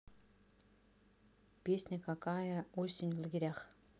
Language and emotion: Russian, neutral